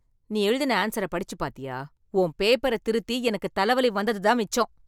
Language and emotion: Tamil, angry